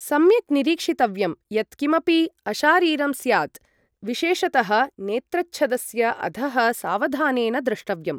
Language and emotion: Sanskrit, neutral